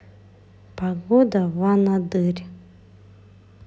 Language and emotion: Russian, neutral